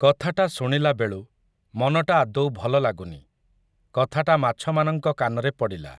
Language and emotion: Odia, neutral